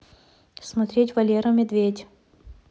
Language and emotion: Russian, neutral